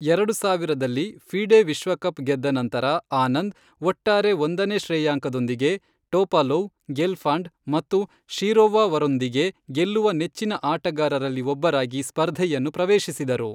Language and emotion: Kannada, neutral